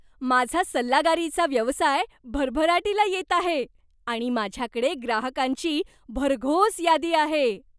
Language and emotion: Marathi, happy